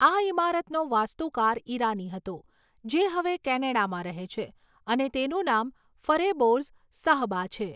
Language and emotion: Gujarati, neutral